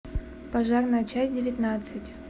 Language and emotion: Russian, neutral